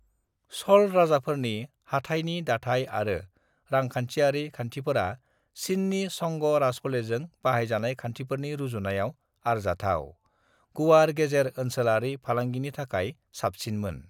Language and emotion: Bodo, neutral